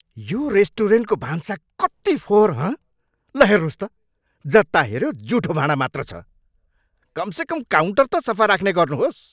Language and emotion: Nepali, angry